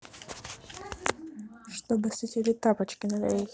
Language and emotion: Russian, neutral